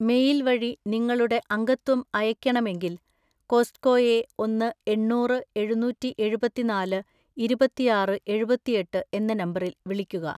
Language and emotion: Malayalam, neutral